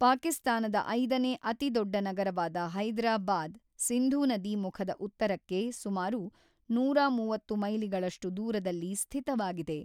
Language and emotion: Kannada, neutral